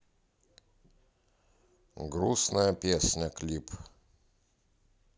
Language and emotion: Russian, neutral